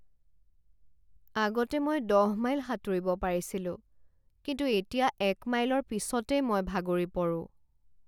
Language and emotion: Assamese, sad